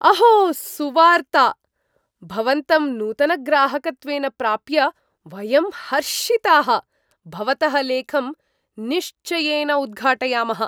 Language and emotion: Sanskrit, surprised